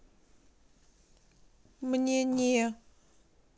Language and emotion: Russian, sad